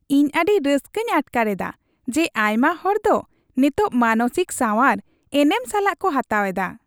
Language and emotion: Santali, happy